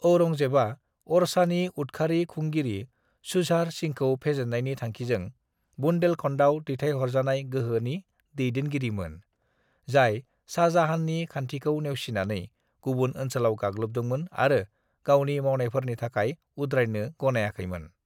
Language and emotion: Bodo, neutral